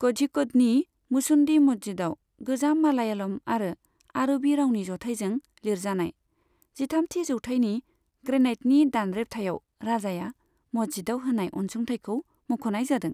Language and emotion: Bodo, neutral